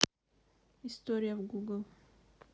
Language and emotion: Russian, neutral